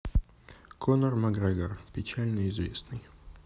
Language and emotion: Russian, neutral